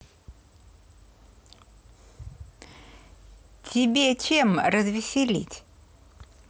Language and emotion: Russian, neutral